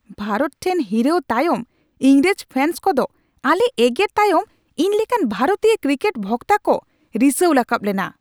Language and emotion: Santali, angry